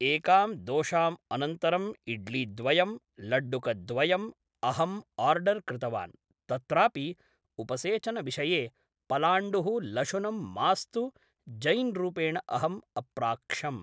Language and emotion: Sanskrit, neutral